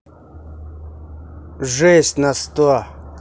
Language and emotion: Russian, angry